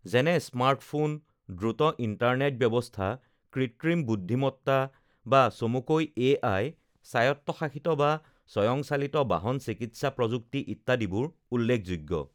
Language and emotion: Assamese, neutral